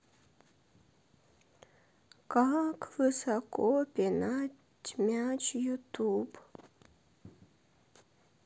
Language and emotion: Russian, sad